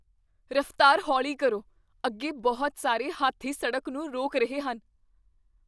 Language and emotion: Punjabi, fearful